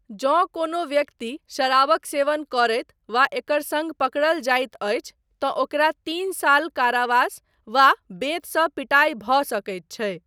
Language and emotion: Maithili, neutral